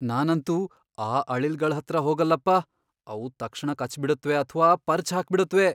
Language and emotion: Kannada, fearful